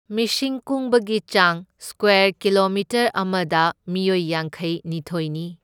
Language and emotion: Manipuri, neutral